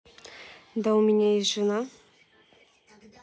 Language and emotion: Russian, neutral